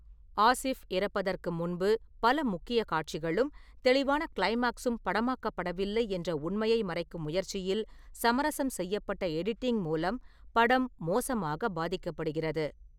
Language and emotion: Tamil, neutral